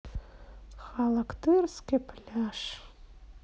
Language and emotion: Russian, sad